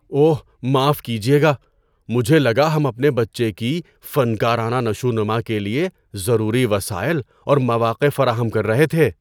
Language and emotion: Urdu, surprised